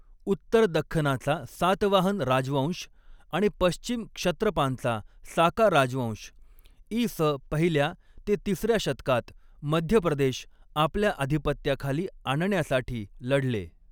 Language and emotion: Marathi, neutral